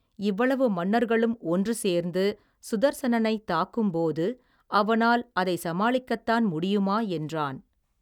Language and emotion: Tamil, neutral